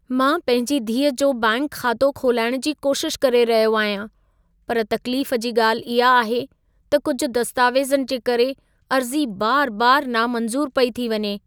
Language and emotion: Sindhi, sad